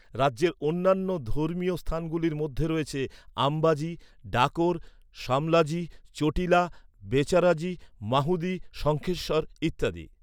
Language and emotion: Bengali, neutral